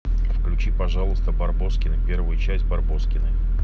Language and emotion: Russian, neutral